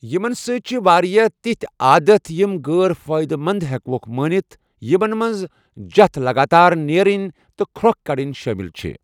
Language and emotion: Kashmiri, neutral